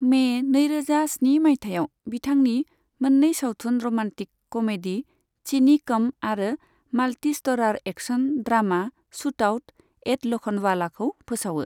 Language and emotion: Bodo, neutral